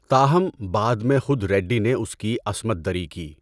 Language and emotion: Urdu, neutral